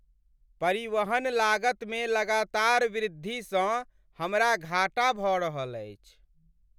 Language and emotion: Maithili, sad